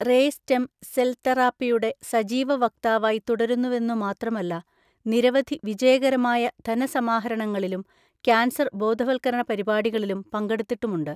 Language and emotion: Malayalam, neutral